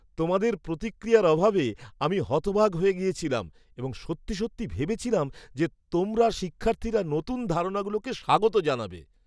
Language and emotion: Bengali, surprised